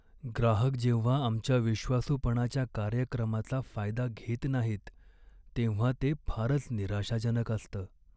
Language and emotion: Marathi, sad